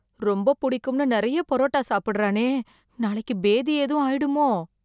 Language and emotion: Tamil, fearful